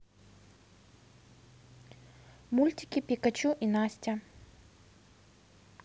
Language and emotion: Russian, neutral